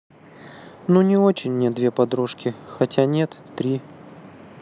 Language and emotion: Russian, sad